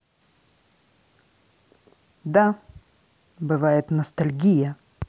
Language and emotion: Russian, angry